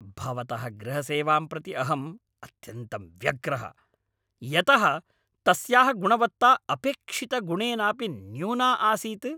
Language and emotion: Sanskrit, angry